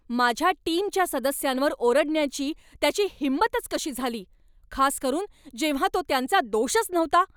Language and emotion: Marathi, angry